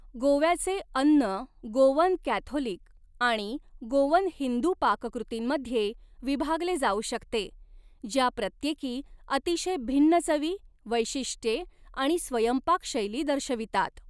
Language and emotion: Marathi, neutral